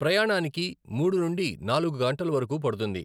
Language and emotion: Telugu, neutral